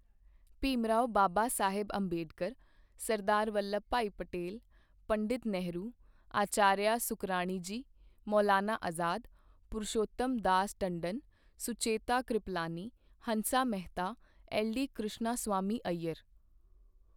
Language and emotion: Punjabi, neutral